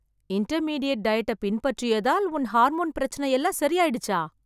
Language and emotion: Tamil, surprised